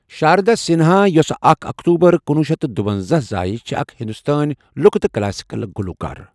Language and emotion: Kashmiri, neutral